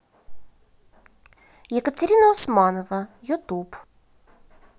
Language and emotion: Russian, positive